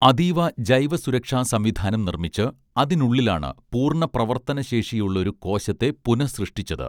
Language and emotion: Malayalam, neutral